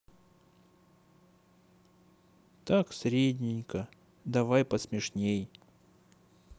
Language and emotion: Russian, sad